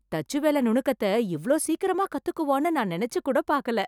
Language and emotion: Tamil, surprised